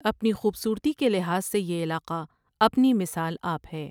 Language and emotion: Urdu, neutral